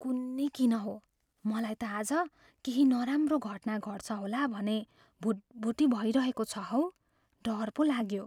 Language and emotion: Nepali, fearful